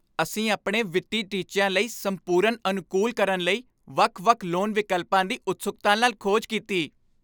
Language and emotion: Punjabi, happy